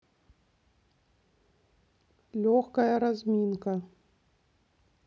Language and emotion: Russian, neutral